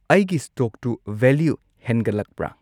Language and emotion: Manipuri, neutral